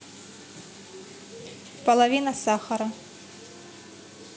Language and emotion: Russian, neutral